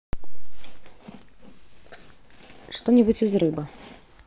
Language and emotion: Russian, neutral